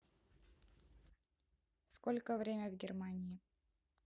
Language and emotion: Russian, neutral